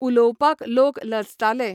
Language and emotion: Goan Konkani, neutral